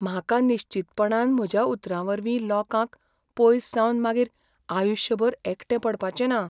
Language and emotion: Goan Konkani, fearful